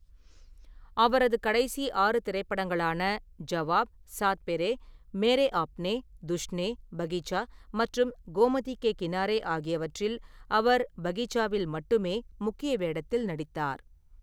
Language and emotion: Tamil, neutral